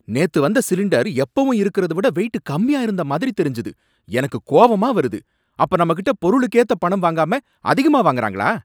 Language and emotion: Tamil, angry